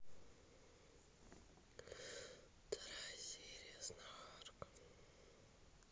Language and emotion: Russian, sad